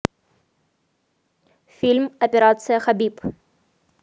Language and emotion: Russian, positive